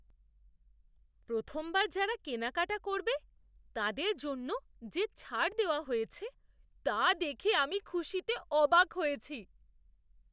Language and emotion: Bengali, surprised